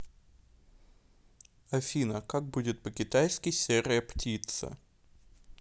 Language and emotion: Russian, neutral